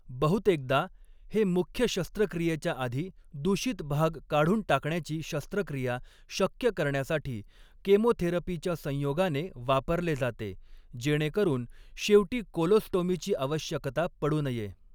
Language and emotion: Marathi, neutral